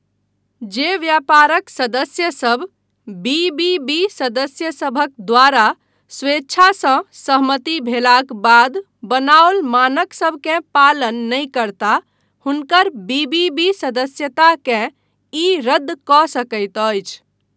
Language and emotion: Maithili, neutral